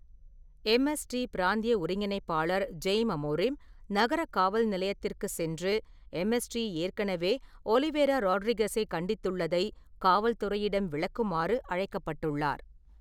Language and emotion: Tamil, neutral